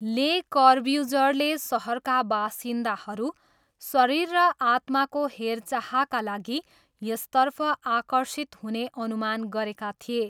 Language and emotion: Nepali, neutral